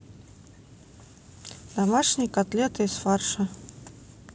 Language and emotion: Russian, neutral